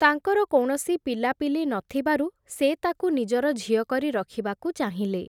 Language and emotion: Odia, neutral